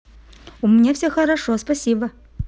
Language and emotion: Russian, positive